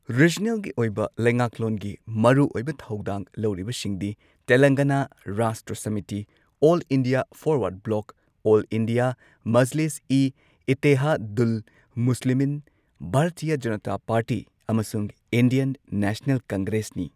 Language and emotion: Manipuri, neutral